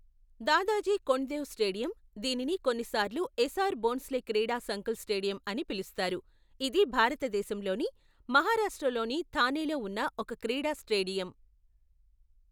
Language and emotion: Telugu, neutral